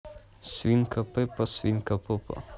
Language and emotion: Russian, neutral